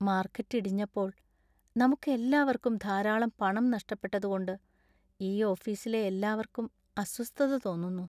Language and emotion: Malayalam, sad